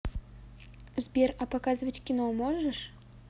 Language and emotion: Russian, neutral